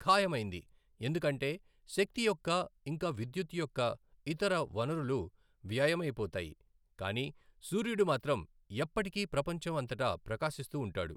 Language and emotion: Telugu, neutral